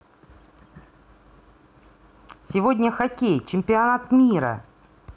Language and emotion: Russian, positive